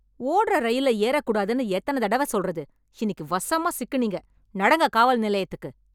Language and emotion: Tamil, angry